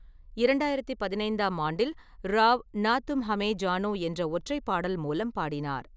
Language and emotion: Tamil, neutral